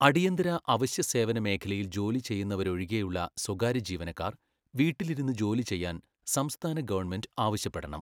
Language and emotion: Malayalam, neutral